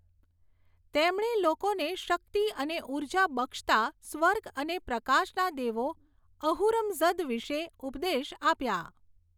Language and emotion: Gujarati, neutral